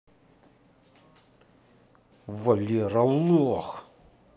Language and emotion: Russian, angry